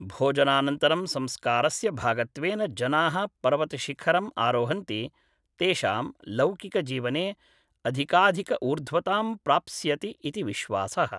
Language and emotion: Sanskrit, neutral